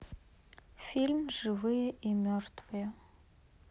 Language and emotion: Russian, sad